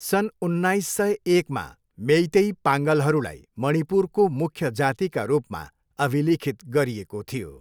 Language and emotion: Nepali, neutral